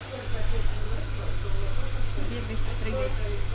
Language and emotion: Russian, neutral